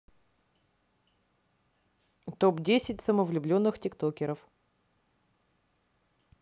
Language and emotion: Russian, neutral